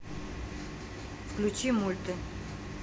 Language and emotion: Russian, neutral